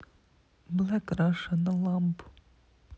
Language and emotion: Russian, sad